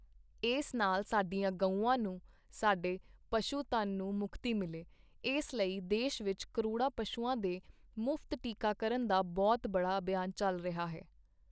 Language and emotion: Punjabi, neutral